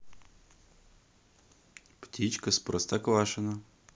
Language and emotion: Russian, positive